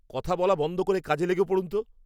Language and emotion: Bengali, angry